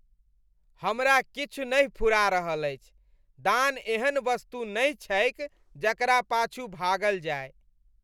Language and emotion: Maithili, disgusted